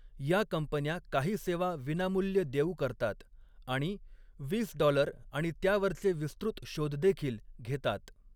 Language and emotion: Marathi, neutral